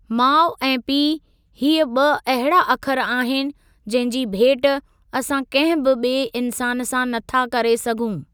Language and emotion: Sindhi, neutral